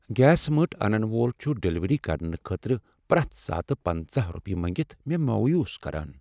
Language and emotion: Kashmiri, sad